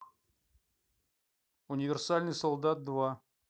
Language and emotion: Russian, neutral